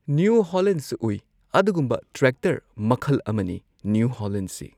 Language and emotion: Manipuri, neutral